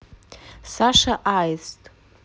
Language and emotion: Russian, neutral